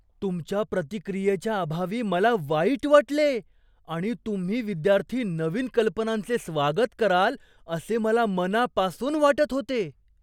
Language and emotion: Marathi, surprised